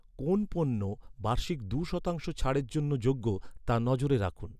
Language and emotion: Bengali, neutral